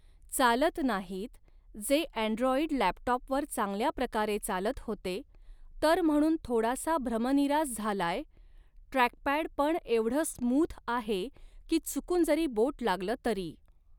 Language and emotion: Marathi, neutral